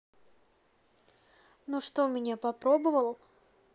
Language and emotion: Russian, neutral